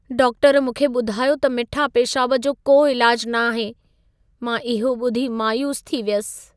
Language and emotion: Sindhi, sad